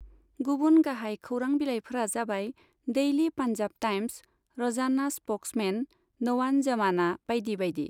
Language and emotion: Bodo, neutral